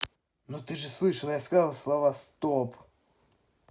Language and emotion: Russian, angry